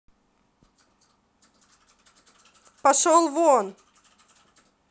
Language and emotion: Russian, angry